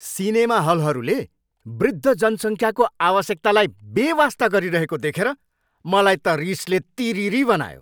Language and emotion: Nepali, angry